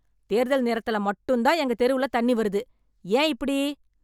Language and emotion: Tamil, angry